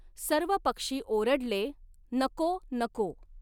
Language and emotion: Marathi, neutral